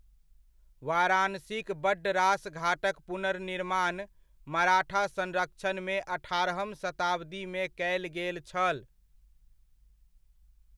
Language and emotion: Maithili, neutral